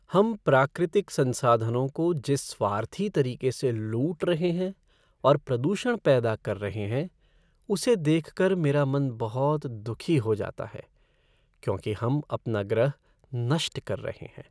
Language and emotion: Hindi, sad